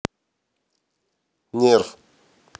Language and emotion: Russian, neutral